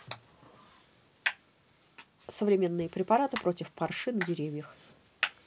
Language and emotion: Russian, neutral